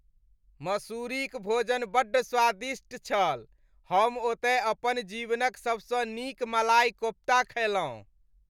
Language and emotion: Maithili, happy